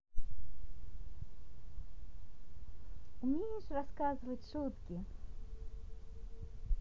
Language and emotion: Russian, positive